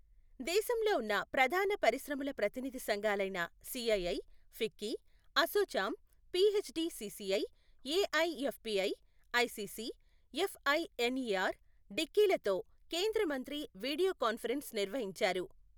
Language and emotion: Telugu, neutral